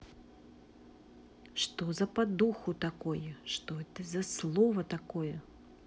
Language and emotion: Russian, angry